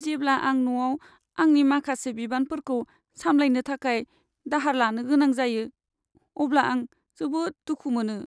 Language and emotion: Bodo, sad